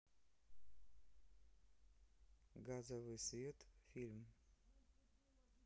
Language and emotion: Russian, neutral